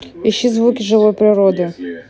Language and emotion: Russian, neutral